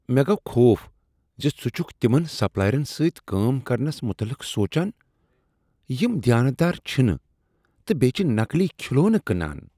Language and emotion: Kashmiri, disgusted